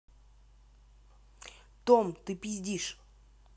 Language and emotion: Russian, angry